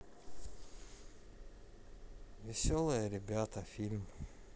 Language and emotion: Russian, sad